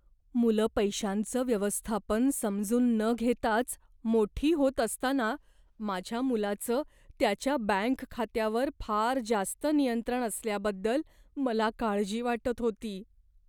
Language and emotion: Marathi, fearful